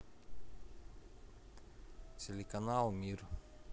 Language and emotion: Russian, neutral